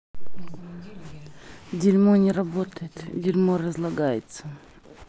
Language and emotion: Russian, angry